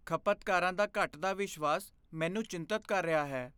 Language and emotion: Punjabi, fearful